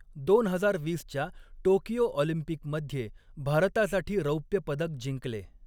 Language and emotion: Marathi, neutral